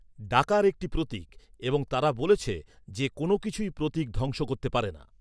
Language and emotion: Bengali, neutral